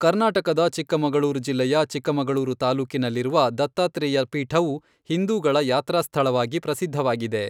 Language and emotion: Kannada, neutral